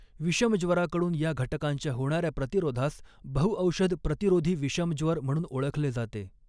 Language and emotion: Marathi, neutral